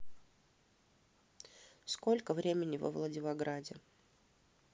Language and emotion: Russian, neutral